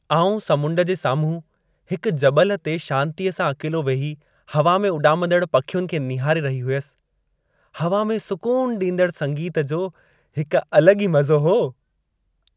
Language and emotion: Sindhi, happy